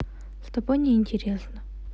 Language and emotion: Russian, neutral